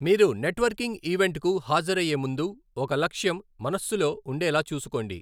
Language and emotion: Telugu, neutral